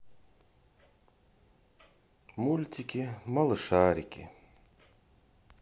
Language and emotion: Russian, sad